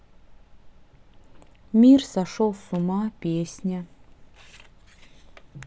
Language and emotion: Russian, sad